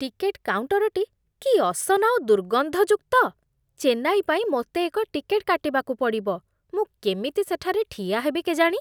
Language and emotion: Odia, disgusted